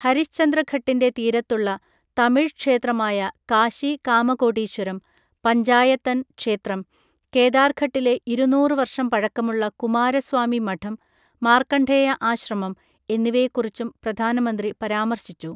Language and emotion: Malayalam, neutral